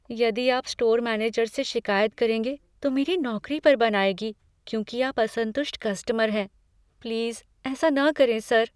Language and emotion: Hindi, fearful